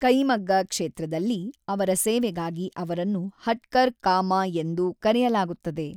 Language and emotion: Kannada, neutral